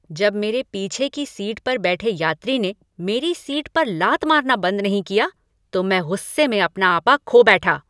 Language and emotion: Hindi, angry